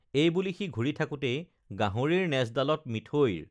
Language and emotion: Assamese, neutral